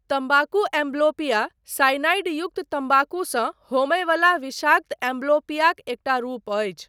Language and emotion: Maithili, neutral